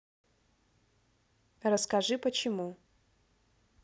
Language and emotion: Russian, neutral